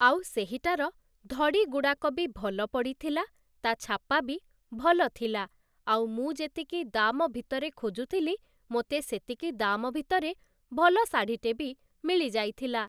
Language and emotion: Odia, neutral